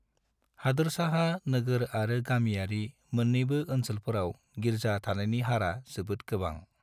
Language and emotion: Bodo, neutral